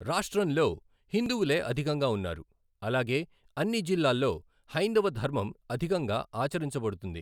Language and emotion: Telugu, neutral